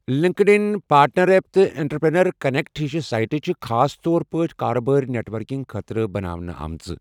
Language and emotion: Kashmiri, neutral